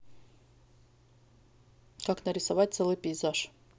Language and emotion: Russian, neutral